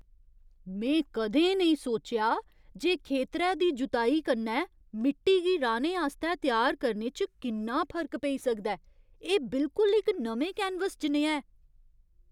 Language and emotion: Dogri, surprised